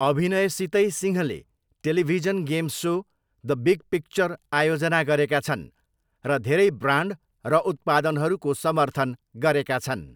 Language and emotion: Nepali, neutral